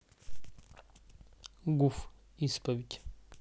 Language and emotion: Russian, neutral